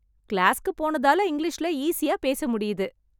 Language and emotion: Tamil, happy